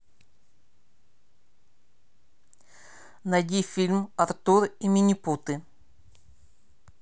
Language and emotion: Russian, neutral